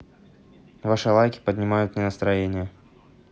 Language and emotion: Russian, neutral